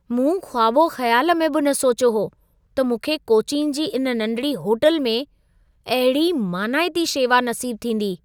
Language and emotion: Sindhi, surprised